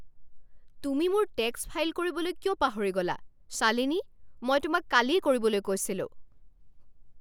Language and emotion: Assamese, angry